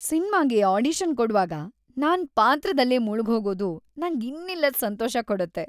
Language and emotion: Kannada, happy